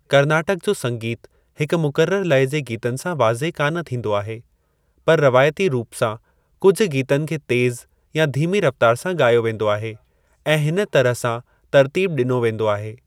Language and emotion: Sindhi, neutral